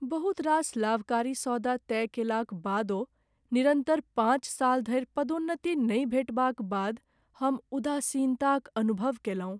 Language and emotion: Maithili, sad